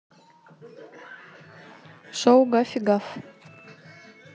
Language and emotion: Russian, neutral